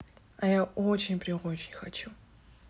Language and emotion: Russian, neutral